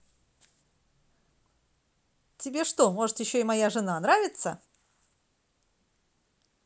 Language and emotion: Russian, positive